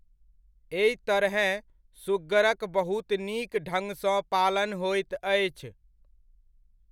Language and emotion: Maithili, neutral